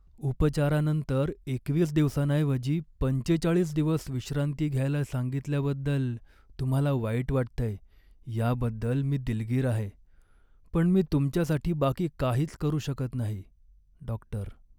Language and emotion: Marathi, sad